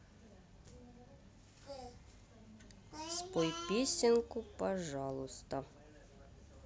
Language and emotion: Russian, neutral